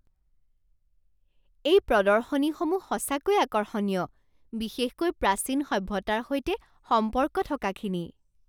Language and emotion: Assamese, surprised